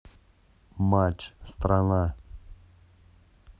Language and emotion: Russian, neutral